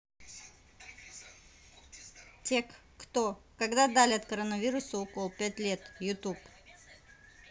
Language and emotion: Russian, neutral